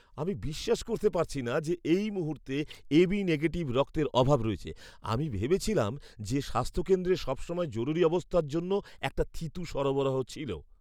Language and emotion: Bengali, surprised